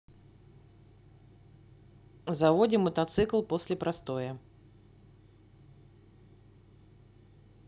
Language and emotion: Russian, neutral